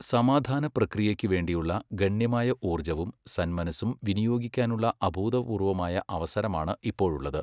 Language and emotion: Malayalam, neutral